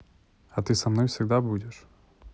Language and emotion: Russian, neutral